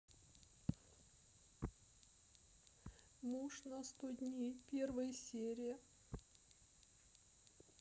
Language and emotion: Russian, sad